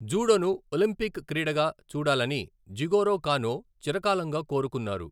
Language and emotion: Telugu, neutral